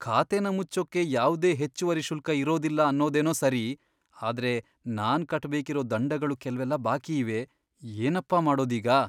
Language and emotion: Kannada, fearful